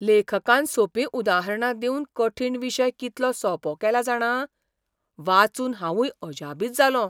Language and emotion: Goan Konkani, surprised